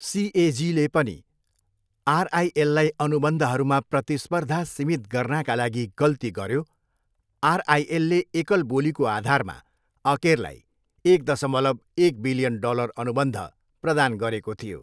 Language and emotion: Nepali, neutral